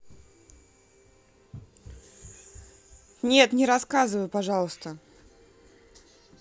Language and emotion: Russian, neutral